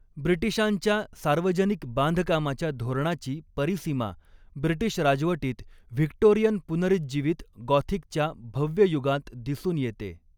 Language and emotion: Marathi, neutral